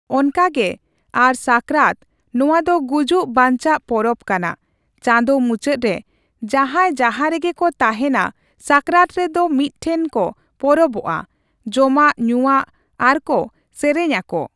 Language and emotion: Santali, neutral